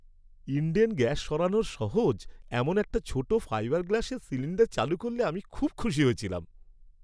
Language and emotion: Bengali, happy